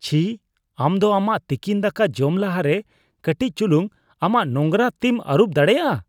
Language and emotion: Santali, disgusted